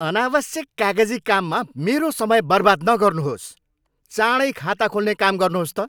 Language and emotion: Nepali, angry